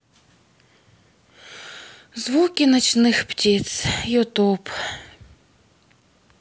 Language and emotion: Russian, sad